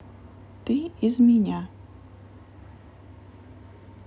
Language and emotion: Russian, neutral